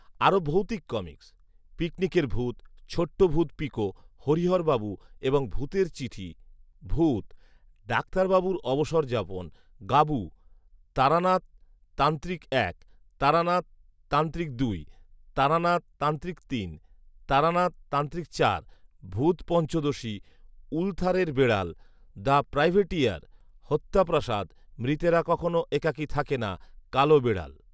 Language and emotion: Bengali, neutral